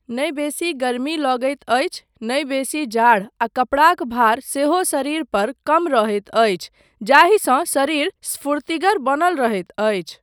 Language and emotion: Maithili, neutral